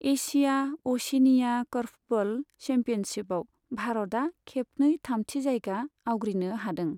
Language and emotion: Bodo, neutral